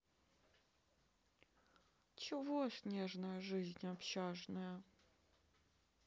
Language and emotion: Russian, sad